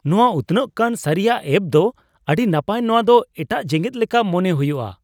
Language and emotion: Santali, surprised